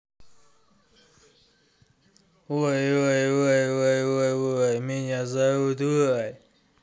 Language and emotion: Russian, angry